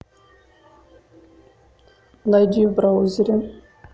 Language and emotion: Russian, neutral